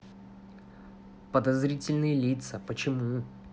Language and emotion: Russian, neutral